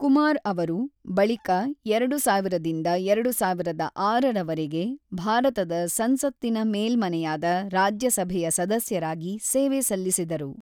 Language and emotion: Kannada, neutral